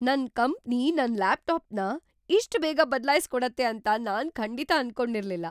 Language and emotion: Kannada, surprised